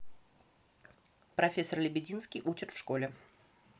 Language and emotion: Russian, neutral